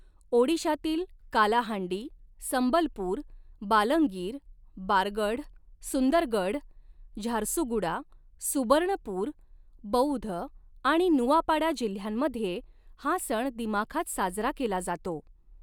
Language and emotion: Marathi, neutral